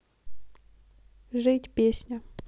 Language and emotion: Russian, neutral